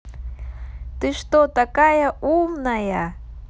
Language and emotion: Russian, positive